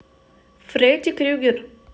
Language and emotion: Russian, neutral